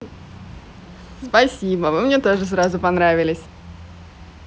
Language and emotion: Russian, positive